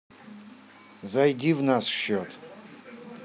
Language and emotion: Russian, neutral